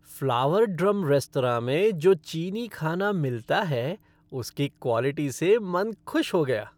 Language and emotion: Hindi, happy